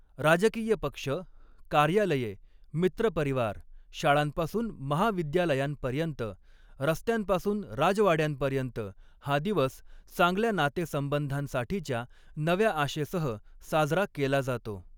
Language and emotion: Marathi, neutral